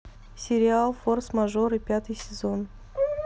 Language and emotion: Russian, neutral